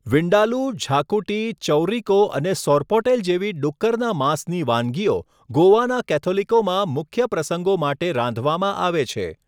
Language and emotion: Gujarati, neutral